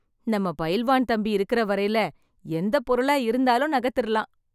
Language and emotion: Tamil, happy